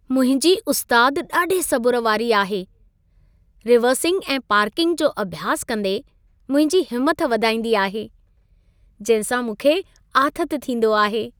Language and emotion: Sindhi, happy